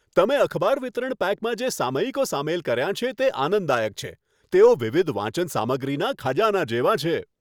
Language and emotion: Gujarati, happy